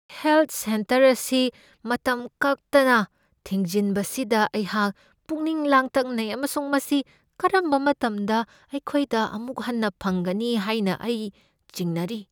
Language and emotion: Manipuri, fearful